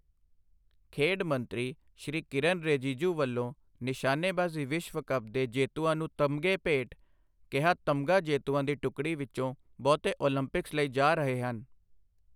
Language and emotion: Punjabi, neutral